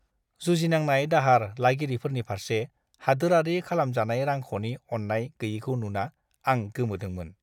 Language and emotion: Bodo, disgusted